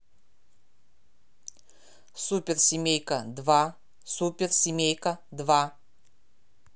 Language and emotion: Russian, neutral